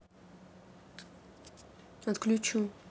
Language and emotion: Russian, neutral